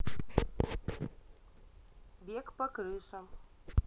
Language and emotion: Russian, neutral